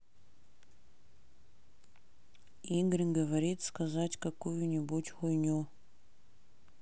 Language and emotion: Russian, neutral